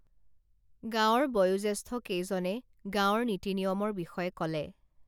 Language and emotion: Assamese, neutral